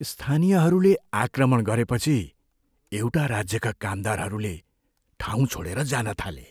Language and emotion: Nepali, fearful